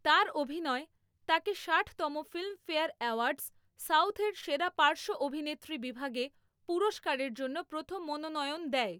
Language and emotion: Bengali, neutral